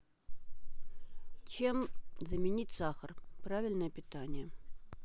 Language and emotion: Russian, neutral